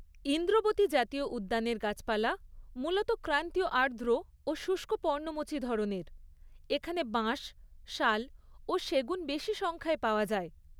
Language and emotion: Bengali, neutral